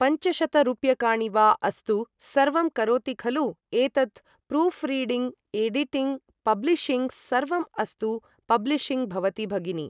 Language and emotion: Sanskrit, neutral